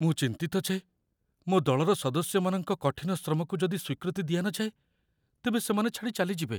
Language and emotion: Odia, fearful